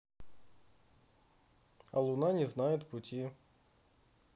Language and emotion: Russian, neutral